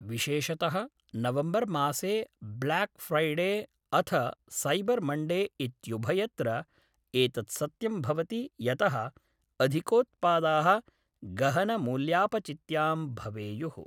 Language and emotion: Sanskrit, neutral